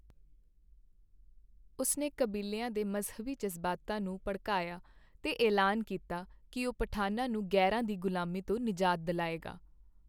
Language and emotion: Punjabi, neutral